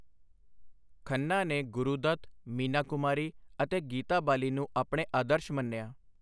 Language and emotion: Punjabi, neutral